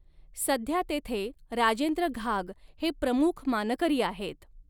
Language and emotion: Marathi, neutral